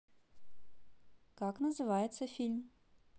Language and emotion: Russian, positive